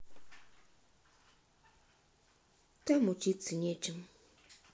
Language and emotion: Russian, sad